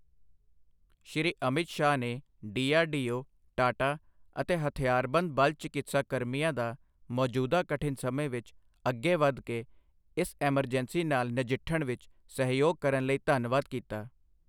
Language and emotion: Punjabi, neutral